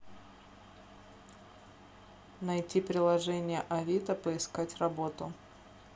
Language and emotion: Russian, neutral